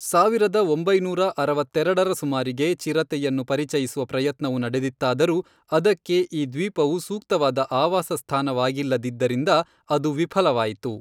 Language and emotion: Kannada, neutral